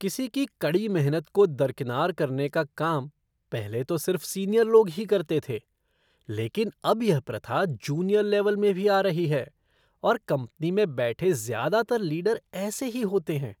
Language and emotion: Hindi, disgusted